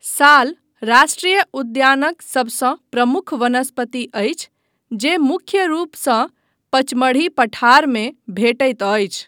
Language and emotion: Maithili, neutral